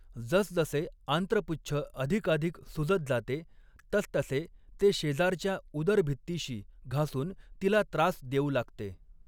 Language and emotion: Marathi, neutral